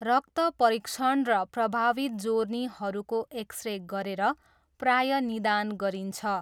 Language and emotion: Nepali, neutral